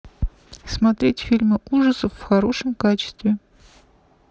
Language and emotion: Russian, neutral